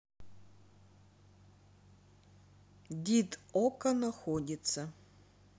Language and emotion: Russian, neutral